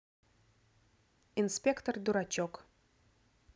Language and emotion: Russian, neutral